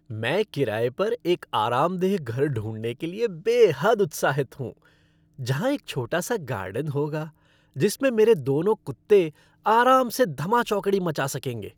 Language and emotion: Hindi, happy